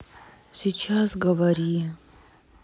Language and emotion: Russian, sad